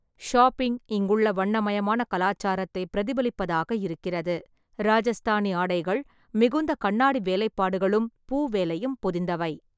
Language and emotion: Tamil, neutral